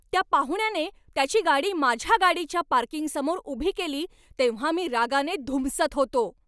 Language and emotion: Marathi, angry